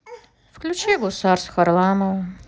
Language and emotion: Russian, neutral